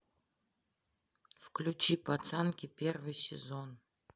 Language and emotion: Russian, neutral